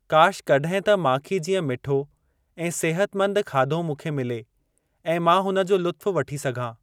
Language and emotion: Sindhi, neutral